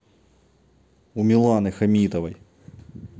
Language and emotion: Russian, neutral